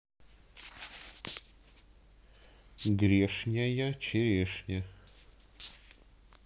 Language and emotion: Russian, neutral